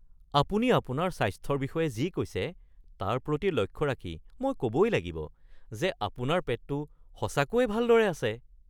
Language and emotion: Assamese, surprised